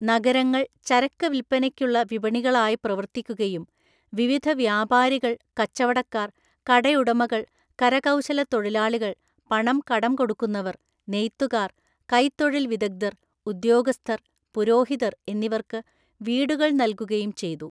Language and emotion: Malayalam, neutral